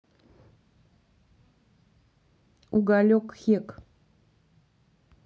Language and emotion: Russian, neutral